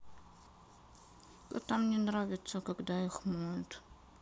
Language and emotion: Russian, sad